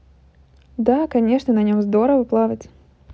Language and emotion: Russian, positive